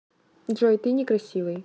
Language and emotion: Russian, neutral